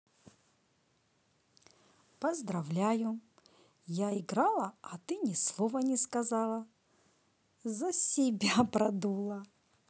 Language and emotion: Russian, positive